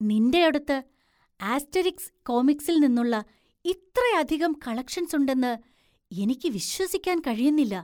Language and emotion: Malayalam, surprised